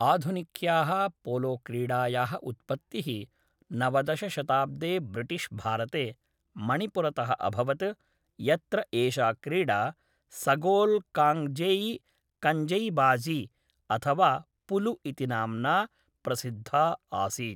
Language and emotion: Sanskrit, neutral